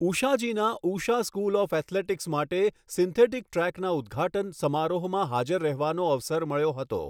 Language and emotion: Gujarati, neutral